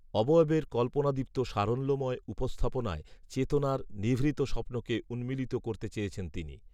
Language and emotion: Bengali, neutral